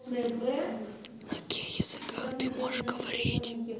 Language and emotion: Russian, neutral